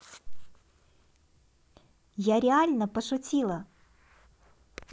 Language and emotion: Russian, positive